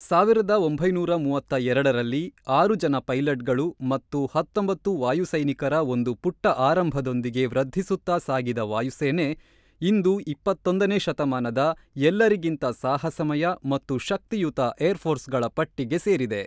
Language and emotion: Kannada, neutral